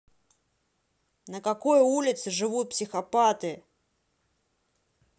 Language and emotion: Russian, angry